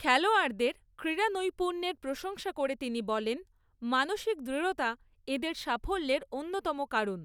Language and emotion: Bengali, neutral